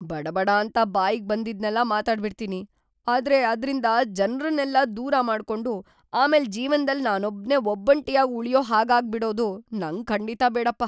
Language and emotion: Kannada, fearful